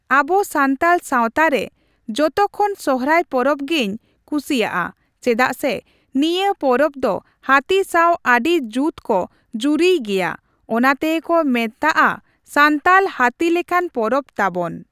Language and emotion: Santali, neutral